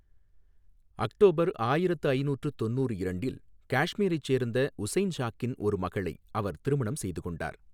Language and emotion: Tamil, neutral